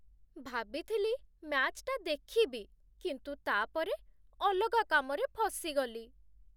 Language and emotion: Odia, sad